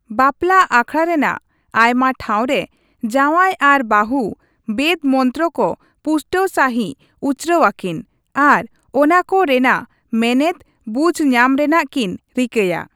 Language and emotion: Santali, neutral